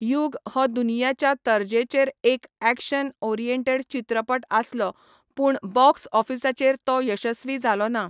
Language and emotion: Goan Konkani, neutral